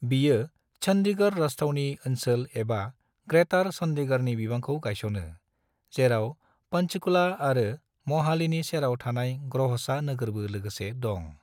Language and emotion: Bodo, neutral